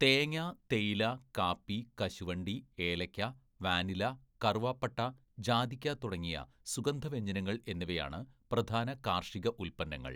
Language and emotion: Malayalam, neutral